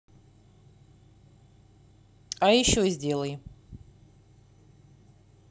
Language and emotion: Russian, neutral